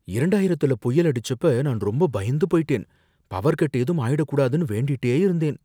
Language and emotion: Tamil, fearful